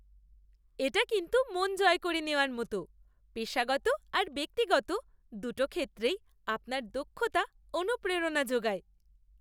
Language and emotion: Bengali, happy